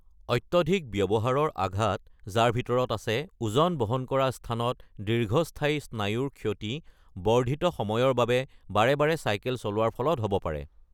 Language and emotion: Assamese, neutral